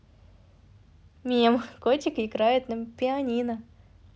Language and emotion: Russian, positive